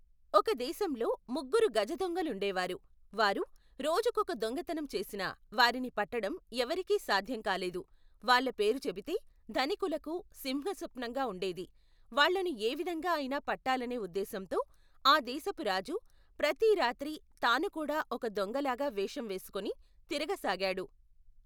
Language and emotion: Telugu, neutral